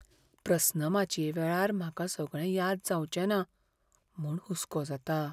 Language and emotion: Goan Konkani, fearful